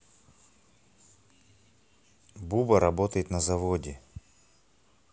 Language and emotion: Russian, neutral